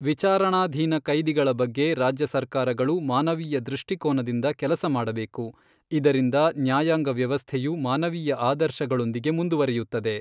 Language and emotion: Kannada, neutral